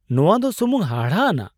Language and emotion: Santali, surprised